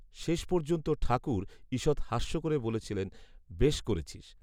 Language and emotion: Bengali, neutral